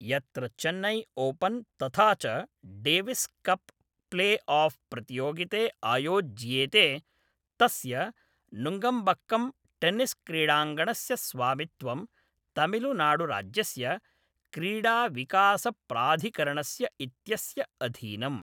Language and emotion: Sanskrit, neutral